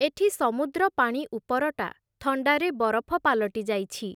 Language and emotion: Odia, neutral